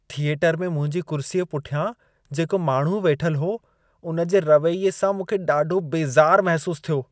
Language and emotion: Sindhi, disgusted